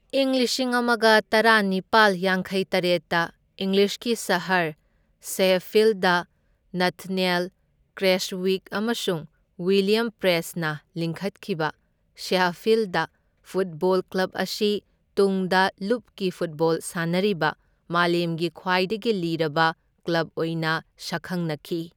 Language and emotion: Manipuri, neutral